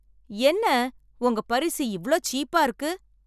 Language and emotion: Tamil, angry